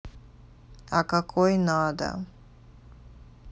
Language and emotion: Russian, sad